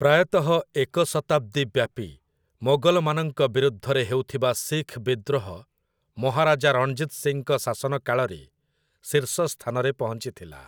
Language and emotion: Odia, neutral